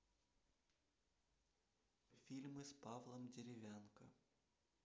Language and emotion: Russian, neutral